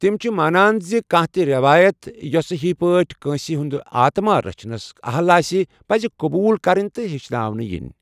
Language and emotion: Kashmiri, neutral